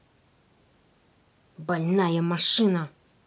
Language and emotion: Russian, angry